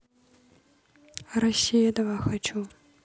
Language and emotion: Russian, neutral